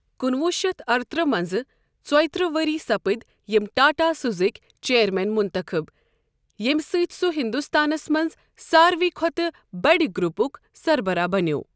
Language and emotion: Kashmiri, neutral